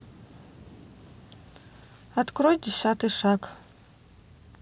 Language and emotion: Russian, neutral